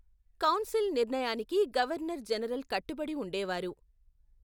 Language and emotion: Telugu, neutral